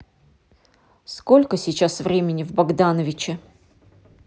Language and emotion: Russian, angry